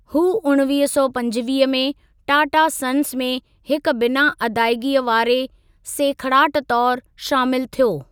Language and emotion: Sindhi, neutral